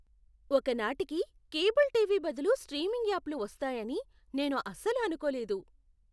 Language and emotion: Telugu, surprised